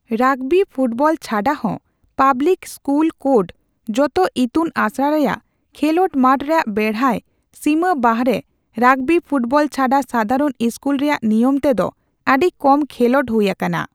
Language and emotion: Santali, neutral